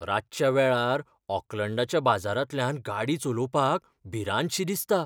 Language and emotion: Goan Konkani, fearful